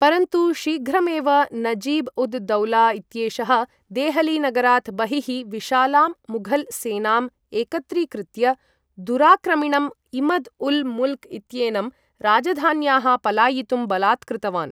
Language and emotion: Sanskrit, neutral